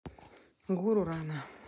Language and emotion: Russian, neutral